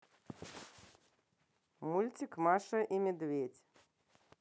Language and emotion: Russian, neutral